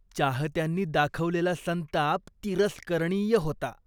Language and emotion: Marathi, disgusted